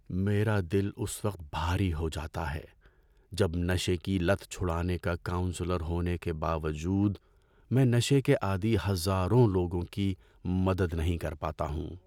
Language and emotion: Urdu, sad